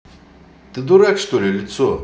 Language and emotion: Russian, angry